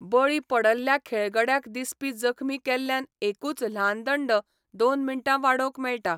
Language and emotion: Goan Konkani, neutral